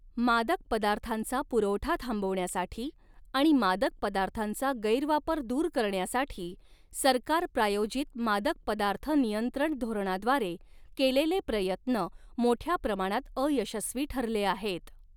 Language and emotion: Marathi, neutral